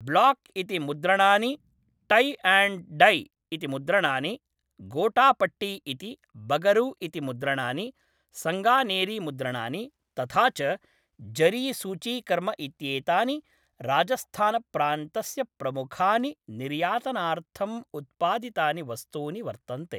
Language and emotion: Sanskrit, neutral